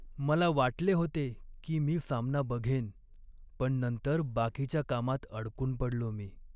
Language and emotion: Marathi, sad